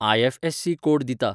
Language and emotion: Goan Konkani, neutral